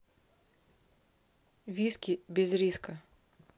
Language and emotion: Russian, neutral